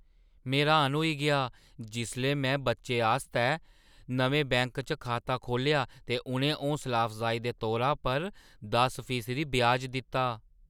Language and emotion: Dogri, surprised